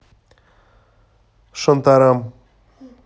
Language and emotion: Russian, neutral